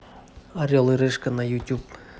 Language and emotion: Russian, neutral